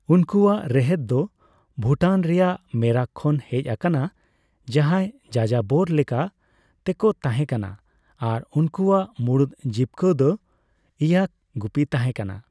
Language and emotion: Santali, neutral